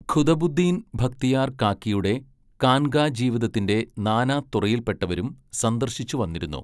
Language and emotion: Malayalam, neutral